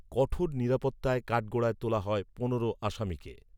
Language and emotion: Bengali, neutral